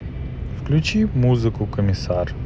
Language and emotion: Russian, neutral